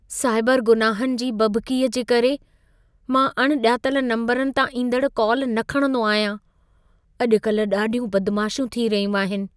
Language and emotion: Sindhi, fearful